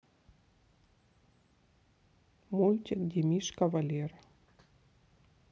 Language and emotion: Russian, neutral